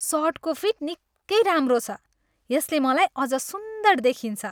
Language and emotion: Nepali, happy